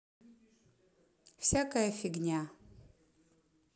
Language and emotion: Russian, neutral